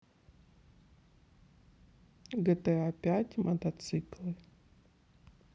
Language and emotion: Russian, neutral